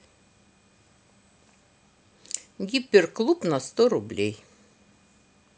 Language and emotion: Russian, neutral